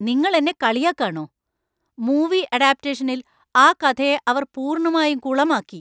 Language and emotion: Malayalam, angry